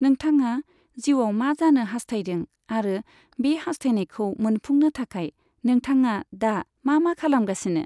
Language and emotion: Bodo, neutral